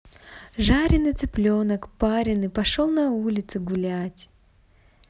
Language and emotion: Russian, positive